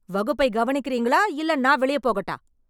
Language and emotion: Tamil, angry